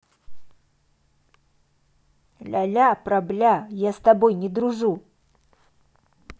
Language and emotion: Russian, angry